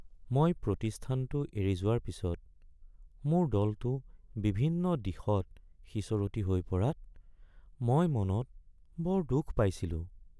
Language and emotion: Assamese, sad